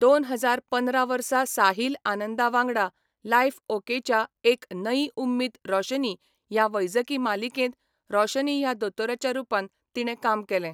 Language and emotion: Goan Konkani, neutral